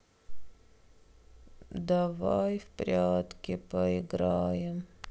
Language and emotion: Russian, sad